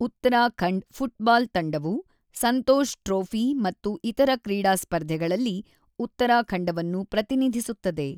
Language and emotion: Kannada, neutral